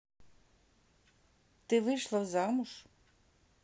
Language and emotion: Russian, neutral